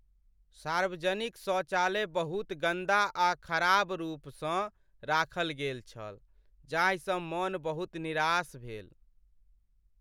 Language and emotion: Maithili, sad